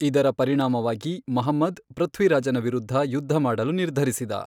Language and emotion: Kannada, neutral